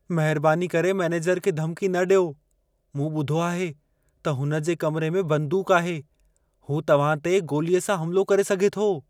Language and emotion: Sindhi, fearful